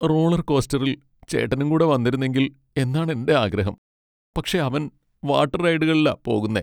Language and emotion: Malayalam, sad